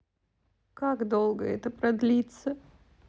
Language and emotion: Russian, sad